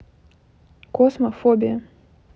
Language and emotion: Russian, neutral